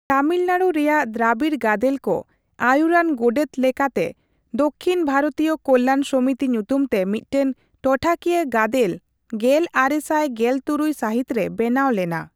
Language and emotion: Santali, neutral